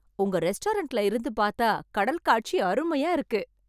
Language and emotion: Tamil, happy